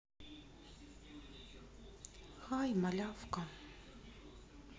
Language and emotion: Russian, sad